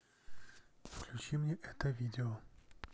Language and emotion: Russian, neutral